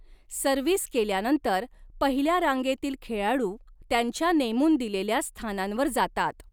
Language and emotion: Marathi, neutral